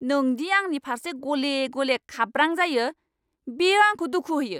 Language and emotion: Bodo, angry